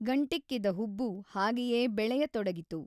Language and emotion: Kannada, neutral